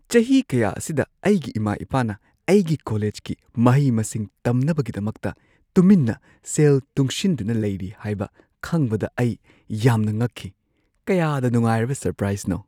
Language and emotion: Manipuri, surprised